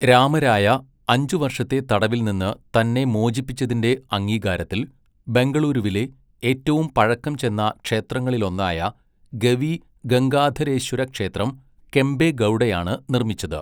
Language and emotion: Malayalam, neutral